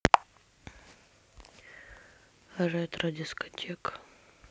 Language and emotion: Russian, sad